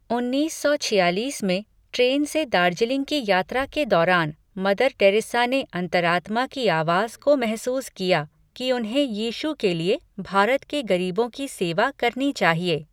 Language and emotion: Hindi, neutral